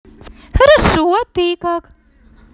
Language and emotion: Russian, positive